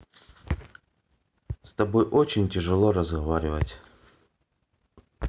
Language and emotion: Russian, sad